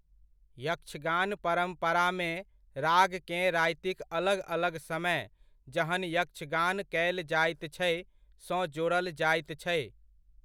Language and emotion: Maithili, neutral